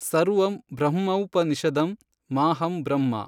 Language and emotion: Kannada, neutral